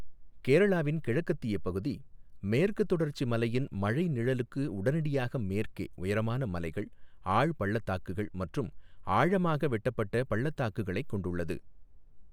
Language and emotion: Tamil, neutral